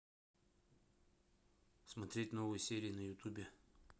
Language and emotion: Russian, neutral